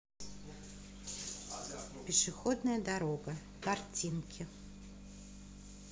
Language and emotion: Russian, positive